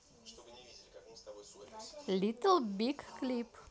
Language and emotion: Russian, positive